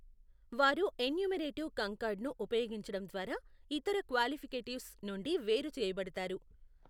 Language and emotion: Telugu, neutral